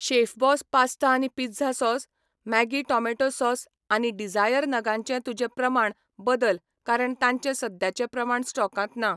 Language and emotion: Goan Konkani, neutral